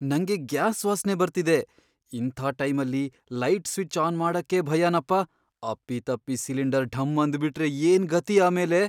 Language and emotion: Kannada, fearful